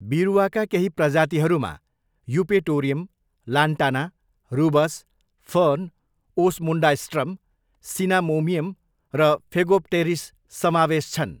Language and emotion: Nepali, neutral